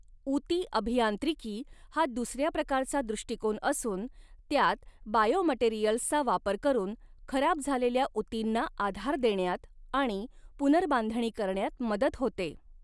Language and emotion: Marathi, neutral